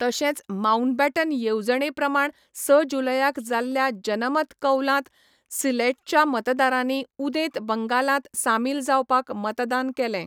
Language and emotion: Goan Konkani, neutral